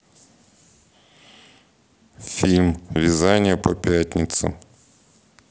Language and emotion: Russian, neutral